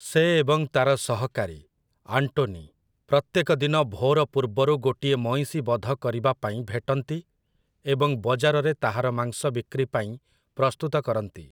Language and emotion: Odia, neutral